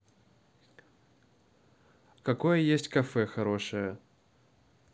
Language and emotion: Russian, neutral